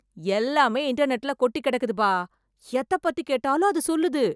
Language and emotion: Tamil, surprised